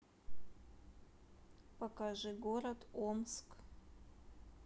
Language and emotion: Russian, neutral